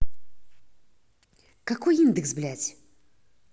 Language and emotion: Russian, angry